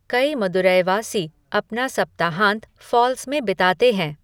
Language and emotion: Hindi, neutral